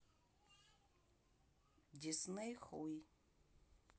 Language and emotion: Russian, neutral